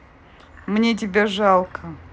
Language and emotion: Russian, neutral